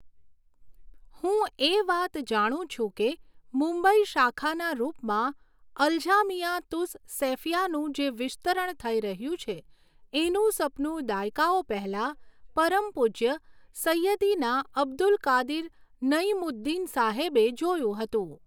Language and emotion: Gujarati, neutral